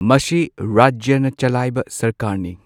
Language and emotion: Manipuri, neutral